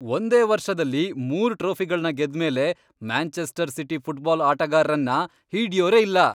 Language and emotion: Kannada, happy